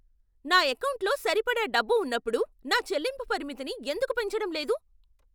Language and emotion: Telugu, angry